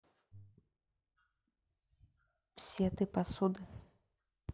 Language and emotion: Russian, neutral